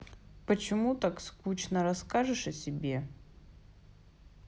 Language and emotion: Russian, neutral